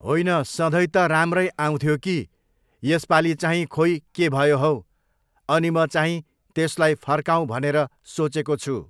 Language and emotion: Nepali, neutral